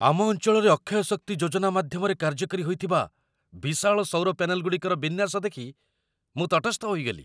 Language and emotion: Odia, surprised